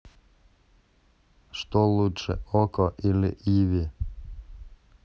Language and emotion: Russian, neutral